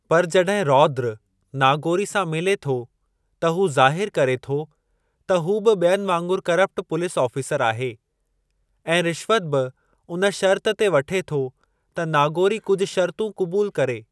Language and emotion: Sindhi, neutral